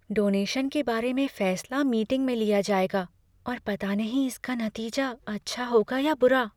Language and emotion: Hindi, fearful